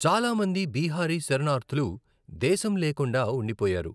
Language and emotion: Telugu, neutral